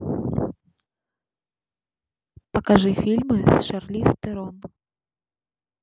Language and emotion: Russian, neutral